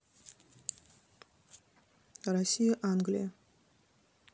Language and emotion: Russian, neutral